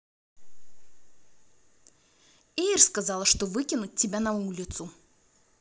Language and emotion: Russian, angry